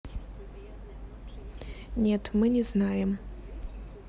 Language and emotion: Russian, neutral